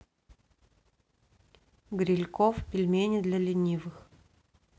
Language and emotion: Russian, neutral